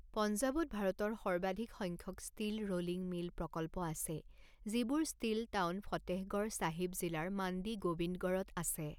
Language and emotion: Assamese, neutral